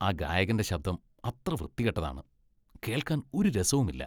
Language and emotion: Malayalam, disgusted